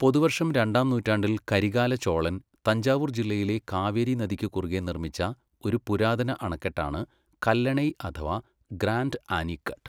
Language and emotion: Malayalam, neutral